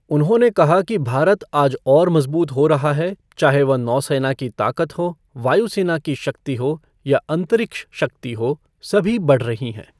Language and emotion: Hindi, neutral